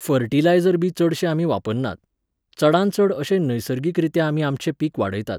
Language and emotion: Goan Konkani, neutral